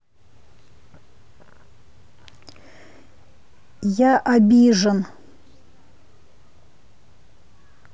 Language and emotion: Russian, neutral